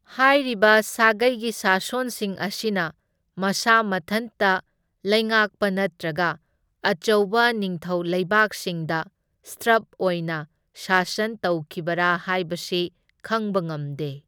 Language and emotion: Manipuri, neutral